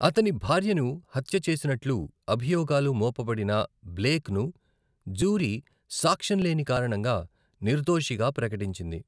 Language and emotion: Telugu, neutral